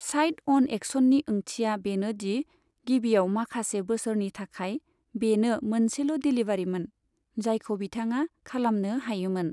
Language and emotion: Bodo, neutral